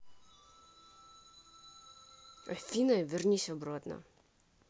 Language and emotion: Russian, angry